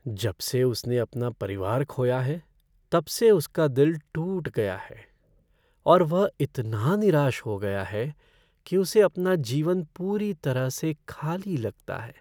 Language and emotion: Hindi, sad